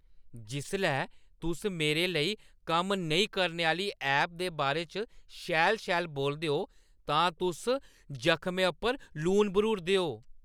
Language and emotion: Dogri, angry